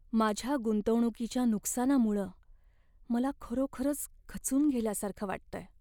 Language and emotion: Marathi, sad